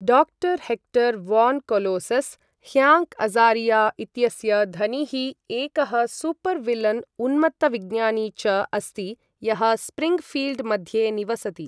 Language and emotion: Sanskrit, neutral